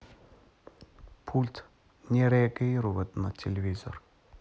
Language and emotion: Russian, neutral